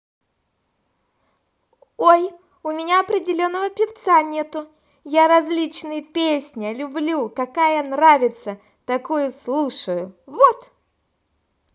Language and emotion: Russian, positive